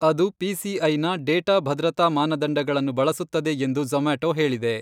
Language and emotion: Kannada, neutral